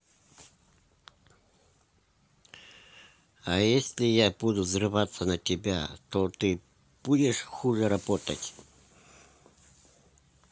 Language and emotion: Russian, neutral